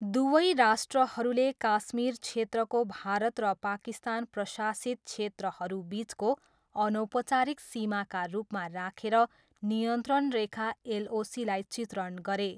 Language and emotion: Nepali, neutral